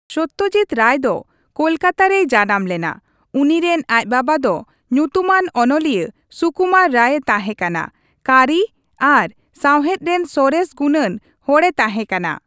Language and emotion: Santali, neutral